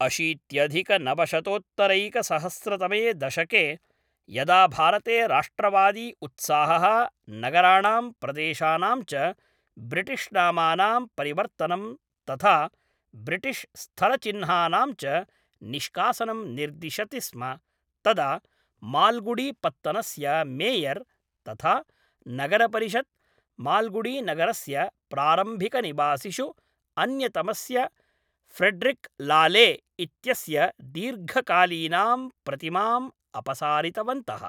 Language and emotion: Sanskrit, neutral